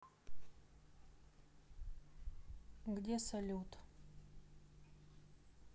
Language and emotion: Russian, neutral